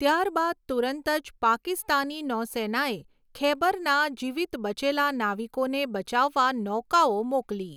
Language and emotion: Gujarati, neutral